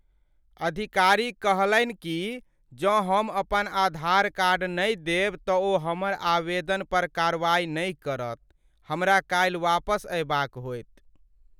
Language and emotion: Maithili, sad